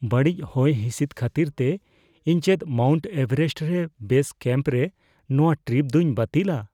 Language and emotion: Santali, fearful